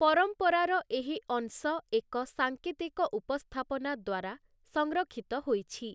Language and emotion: Odia, neutral